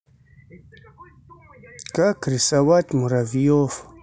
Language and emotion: Russian, sad